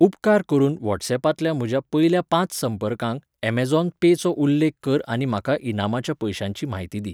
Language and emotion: Goan Konkani, neutral